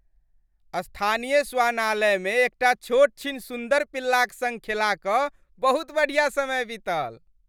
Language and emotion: Maithili, happy